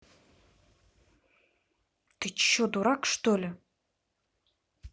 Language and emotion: Russian, angry